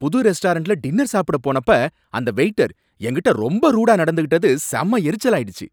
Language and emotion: Tamil, angry